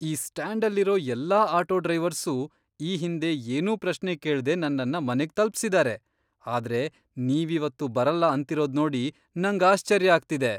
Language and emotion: Kannada, surprised